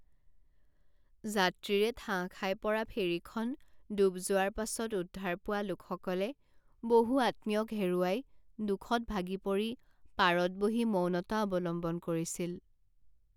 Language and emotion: Assamese, sad